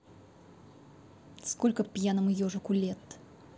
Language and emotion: Russian, angry